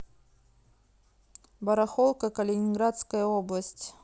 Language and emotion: Russian, neutral